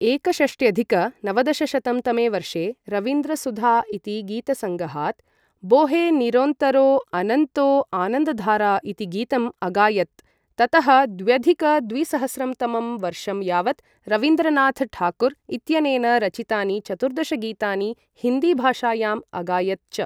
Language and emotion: Sanskrit, neutral